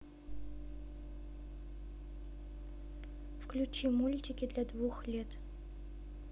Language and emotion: Russian, neutral